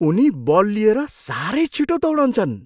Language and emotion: Nepali, surprised